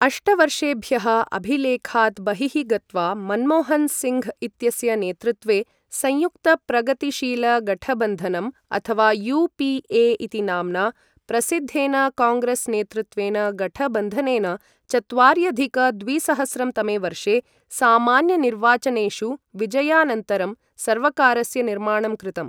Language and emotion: Sanskrit, neutral